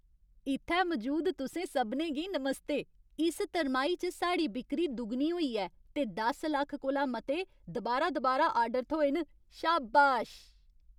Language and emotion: Dogri, happy